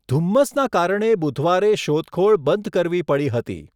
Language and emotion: Gujarati, neutral